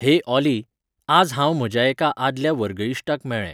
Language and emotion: Goan Konkani, neutral